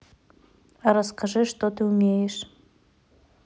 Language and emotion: Russian, neutral